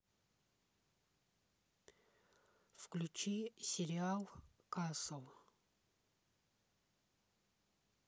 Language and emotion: Russian, neutral